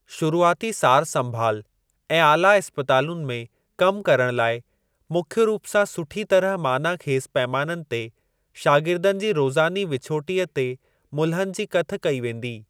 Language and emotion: Sindhi, neutral